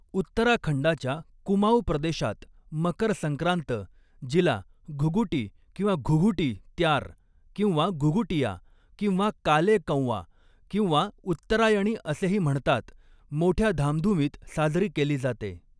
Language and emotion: Marathi, neutral